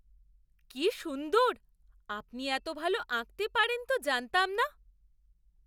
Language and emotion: Bengali, surprised